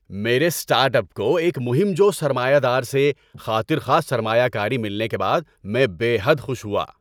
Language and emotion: Urdu, happy